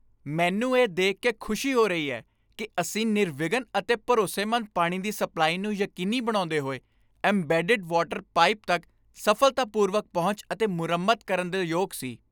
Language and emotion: Punjabi, happy